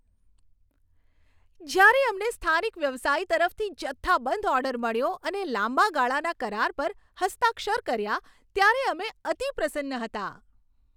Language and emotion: Gujarati, happy